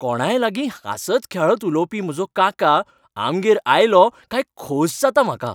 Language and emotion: Goan Konkani, happy